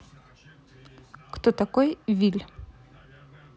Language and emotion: Russian, neutral